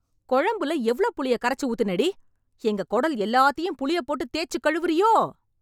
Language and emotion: Tamil, angry